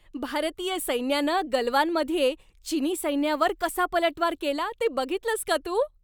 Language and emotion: Marathi, happy